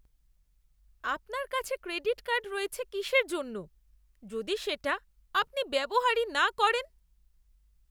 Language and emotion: Bengali, disgusted